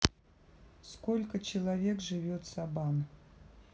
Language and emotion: Russian, neutral